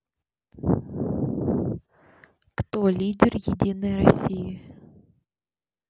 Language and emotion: Russian, neutral